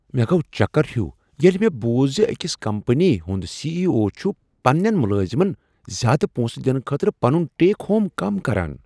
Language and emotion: Kashmiri, surprised